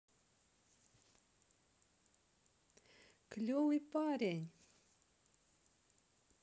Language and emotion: Russian, positive